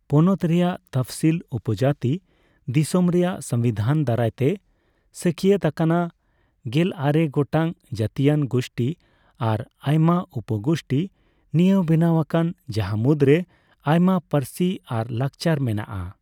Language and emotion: Santali, neutral